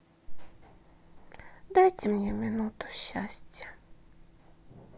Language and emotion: Russian, sad